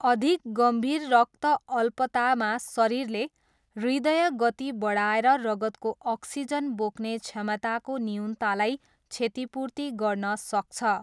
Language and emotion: Nepali, neutral